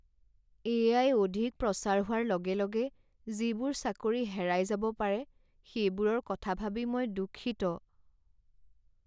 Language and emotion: Assamese, sad